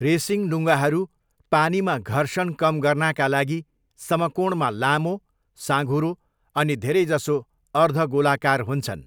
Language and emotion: Nepali, neutral